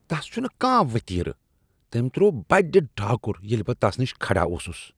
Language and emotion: Kashmiri, disgusted